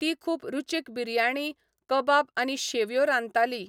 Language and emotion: Goan Konkani, neutral